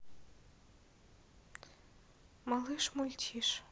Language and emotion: Russian, neutral